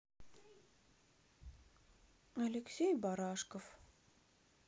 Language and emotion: Russian, sad